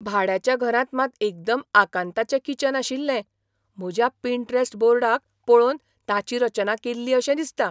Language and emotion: Goan Konkani, surprised